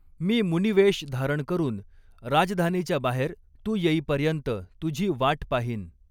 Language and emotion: Marathi, neutral